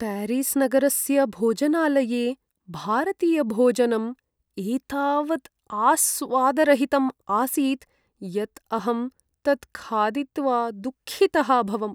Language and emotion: Sanskrit, sad